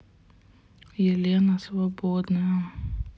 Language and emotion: Russian, sad